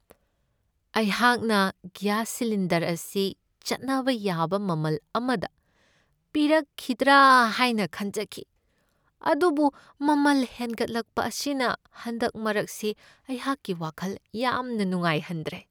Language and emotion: Manipuri, sad